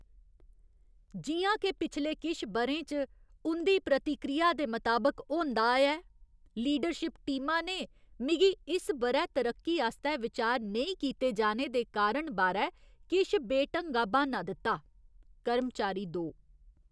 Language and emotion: Dogri, disgusted